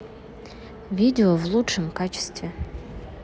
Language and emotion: Russian, neutral